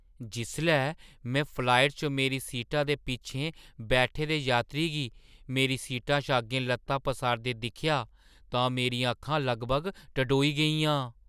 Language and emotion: Dogri, surprised